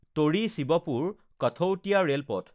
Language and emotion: Assamese, neutral